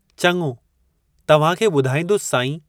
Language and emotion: Sindhi, neutral